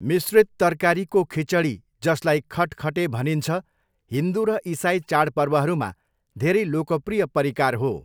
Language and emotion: Nepali, neutral